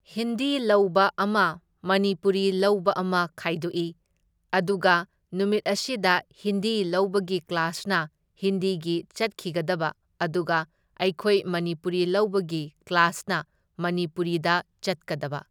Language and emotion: Manipuri, neutral